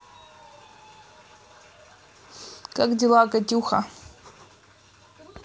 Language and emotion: Russian, neutral